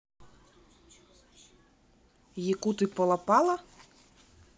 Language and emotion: Russian, neutral